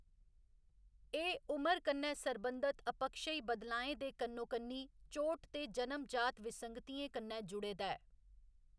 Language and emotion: Dogri, neutral